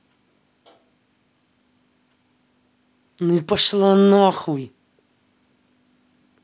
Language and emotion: Russian, angry